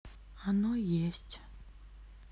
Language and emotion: Russian, sad